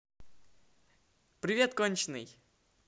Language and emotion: Russian, positive